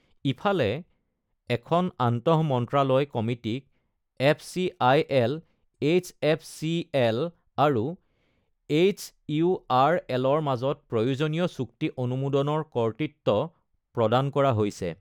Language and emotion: Assamese, neutral